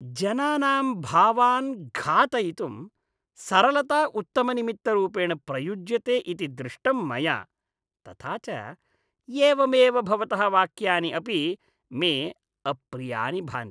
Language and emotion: Sanskrit, disgusted